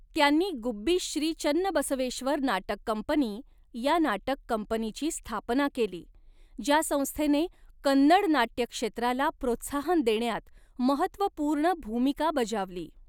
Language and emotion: Marathi, neutral